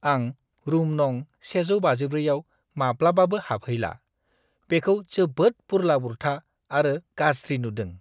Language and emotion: Bodo, disgusted